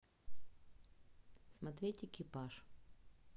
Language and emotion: Russian, neutral